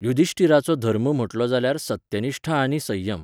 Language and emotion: Goan Konkani, neutral